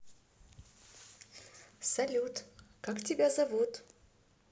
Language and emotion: Russian, positive